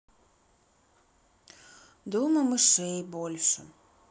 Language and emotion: Russian, sad